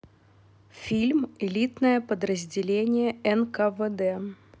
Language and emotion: Russian, neutral